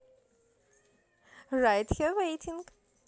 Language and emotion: Russian, positive